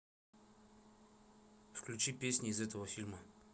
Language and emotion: Russian, neutral